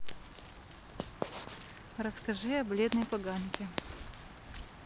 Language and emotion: Russian, neutral